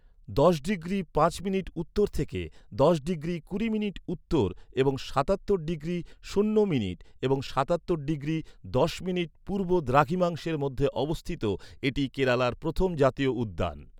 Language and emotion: Bengali, neutral